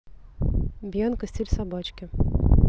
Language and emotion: Russian, neutral